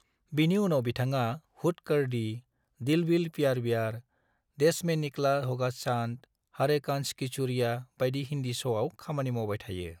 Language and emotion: Bodo, neutral